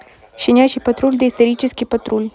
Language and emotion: Russian, neutral